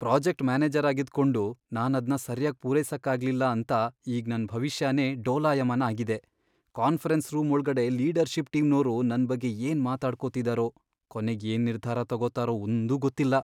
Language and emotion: Kannada, fearful